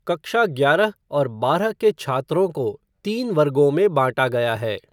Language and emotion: Hindi, neutral